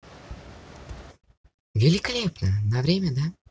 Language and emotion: Russian, positive